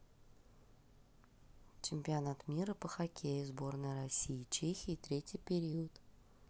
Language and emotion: Russian, neutral